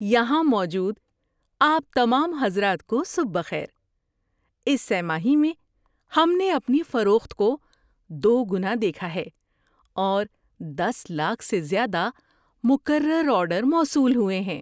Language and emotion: Urdu, happy